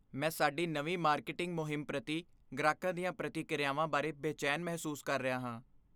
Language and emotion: Punjabi, fearful